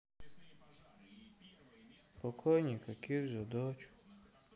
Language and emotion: Russian, sad